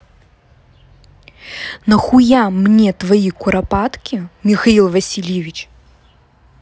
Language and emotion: Russian, angry